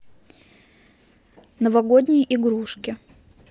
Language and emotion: Russian, neutral